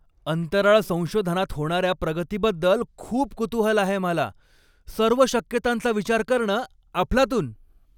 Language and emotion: Marathi, happy